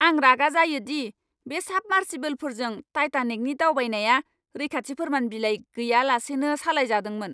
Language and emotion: Bodo, angry